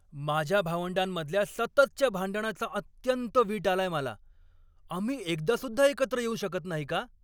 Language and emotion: Marathi, angry